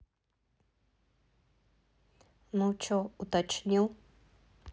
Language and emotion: Russian, neutral